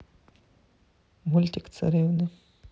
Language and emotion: Russian, neutral